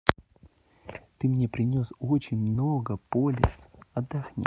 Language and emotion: Russian, neutral